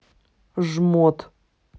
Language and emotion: Russian, angry